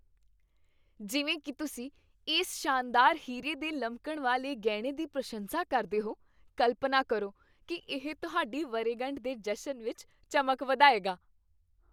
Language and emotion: Punjabi, happy